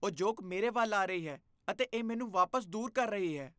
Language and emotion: Punjabi, disgusted